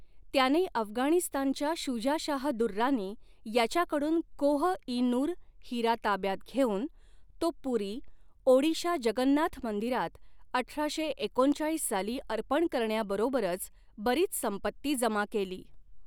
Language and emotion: Marathi, neutral